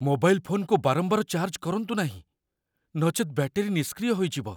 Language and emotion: Odia, fearful